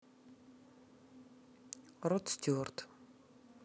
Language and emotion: Russian, neutral